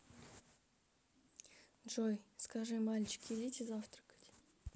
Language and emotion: Russian, sad